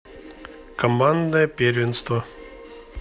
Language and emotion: Russian, neutral